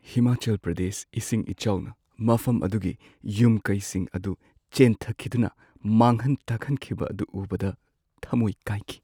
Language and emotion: Manipuri, sad